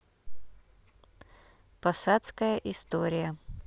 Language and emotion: Russian, neutral